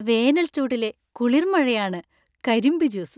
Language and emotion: Malayalam, happy